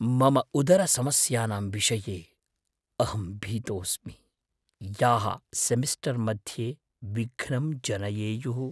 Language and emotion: Sanskrit, fearful